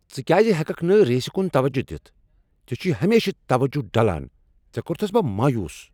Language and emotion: Kashmiri, angry